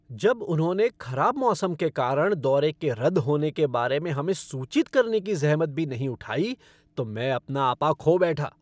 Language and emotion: Hindi, angry